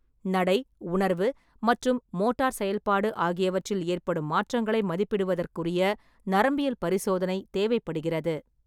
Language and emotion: Tamil, neutral